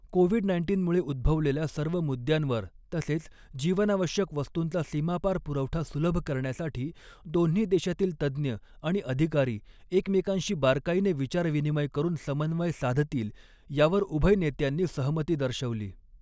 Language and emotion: Marathi, neutral